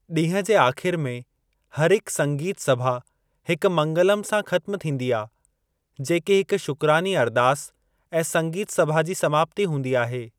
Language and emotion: Sindhi, neutral